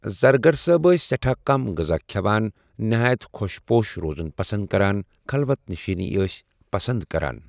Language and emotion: Kashmiri, neutral